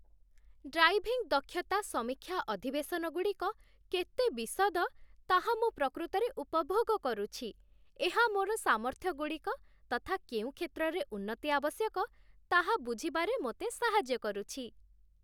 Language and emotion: Odia, happy